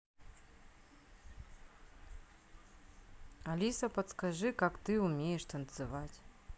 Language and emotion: Russian, neutral